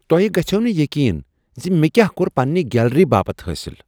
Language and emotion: Kashmiri, surprised